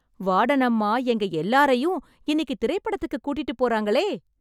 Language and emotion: Tamil, happy